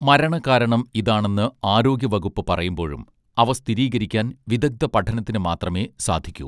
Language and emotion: Malayalam, neutral